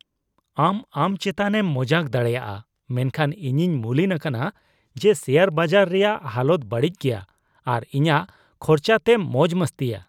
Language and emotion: Santali, disgusted